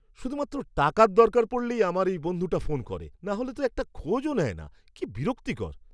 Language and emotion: Bengali, disgusted